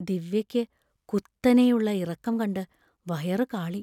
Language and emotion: Malayalam, fearful